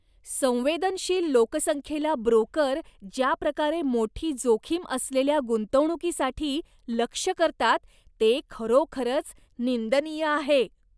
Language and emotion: Marathi, disgusted